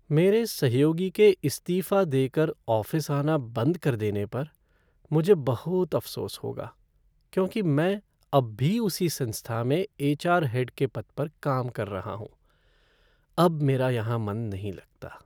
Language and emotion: Hindi, sad